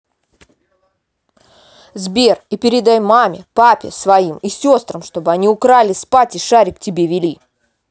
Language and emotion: Russian, angry